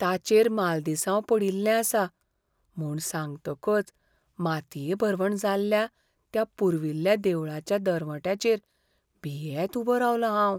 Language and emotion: Goan Konkani, fearful